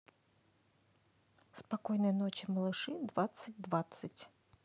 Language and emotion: Russian, neutral